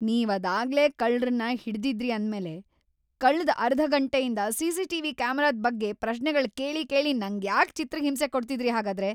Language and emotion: Kannada, angry